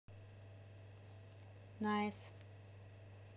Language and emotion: Russian, neutral